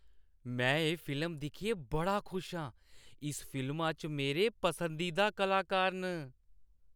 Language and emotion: Dogri, happy